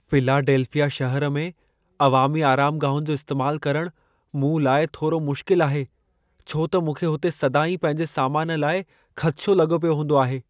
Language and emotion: Sindhi, fearful